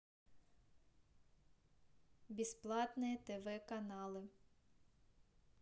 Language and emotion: Russian, neutral